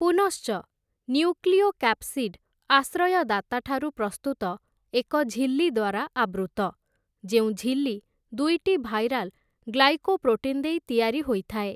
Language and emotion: Odia, neutral